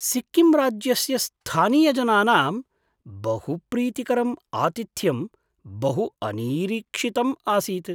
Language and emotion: Sanskrit, surprised